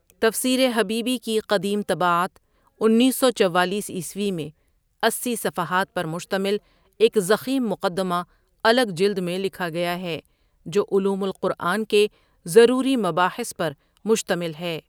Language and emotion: Urdu, neutral